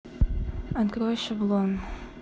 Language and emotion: Russian, neutral